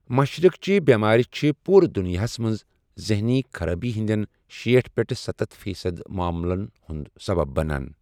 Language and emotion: Kashmiri, neutral